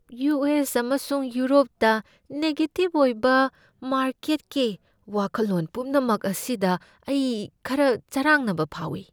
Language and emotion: Manipuri, fearful